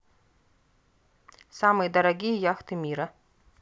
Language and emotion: Russian, neutral